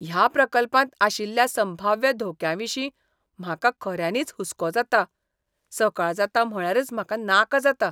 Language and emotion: Goan Konkani, disgusted